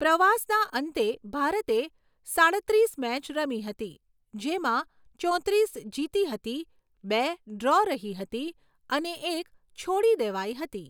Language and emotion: Gujarati, neutral